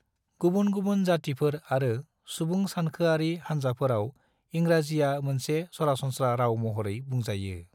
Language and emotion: Bodo, neutral